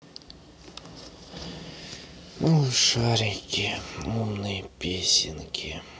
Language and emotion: Russian, sad